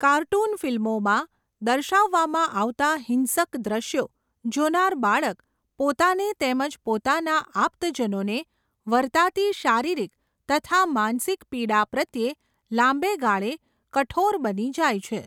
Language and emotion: Gujarati, neutral